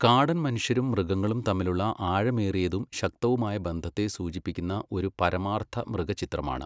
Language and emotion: Malayalam, neutral